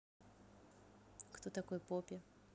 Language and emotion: Russian, neutral